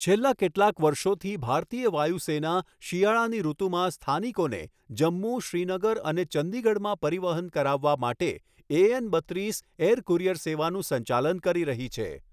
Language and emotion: Gujarati, neutral